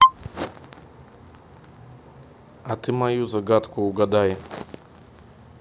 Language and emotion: Russian, neutral